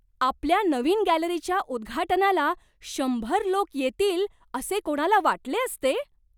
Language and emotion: Marathi, surprised